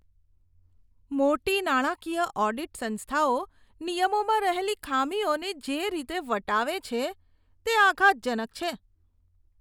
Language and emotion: Gujarati, disgusted